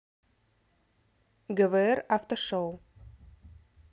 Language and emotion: Russian, neutral